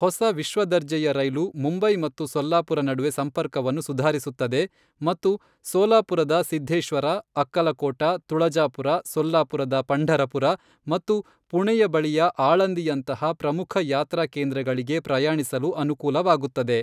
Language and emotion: Kannada, neutral